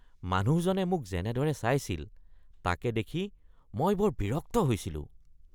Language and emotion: Assamese, disgusted